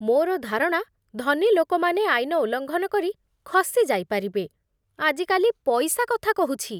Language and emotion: Odia, disgusted